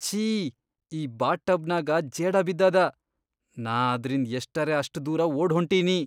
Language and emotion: Kannada, disgusted